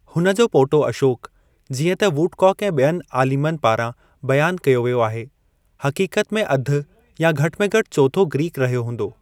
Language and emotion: Sindhi, neutral